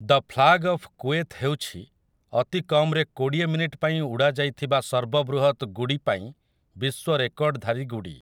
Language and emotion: Odia, neutral